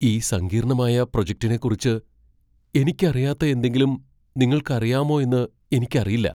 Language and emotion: Malayalam, fearful